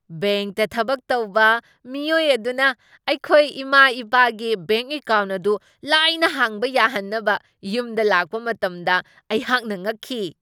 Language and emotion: Manipuri, surprised